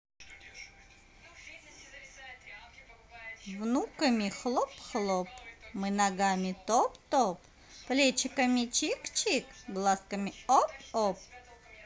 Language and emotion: Russian, positive